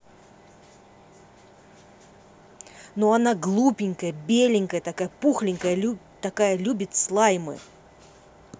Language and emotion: Russian, angry